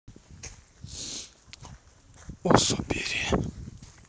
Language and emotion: Russian, neutral